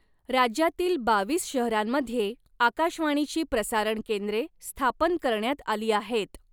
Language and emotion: Marathi, neutral